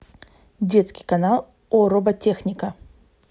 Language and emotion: Russian, neutral